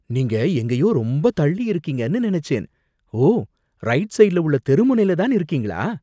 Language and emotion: Tamil, surprised